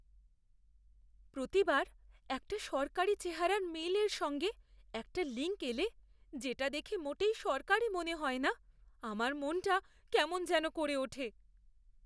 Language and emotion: Bengali, fearful